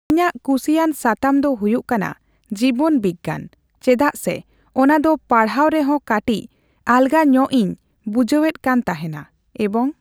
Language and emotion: Santali, neutral